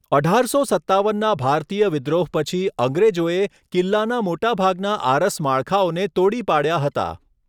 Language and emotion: Gujarati, neutral